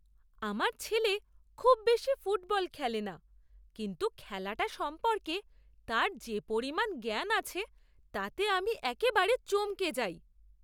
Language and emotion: Bengali, surprised